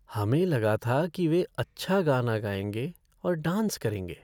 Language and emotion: Hindi, sad